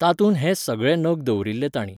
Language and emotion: Goan Konkani, neutral